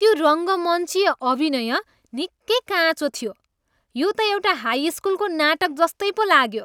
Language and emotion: Nepali, disgusted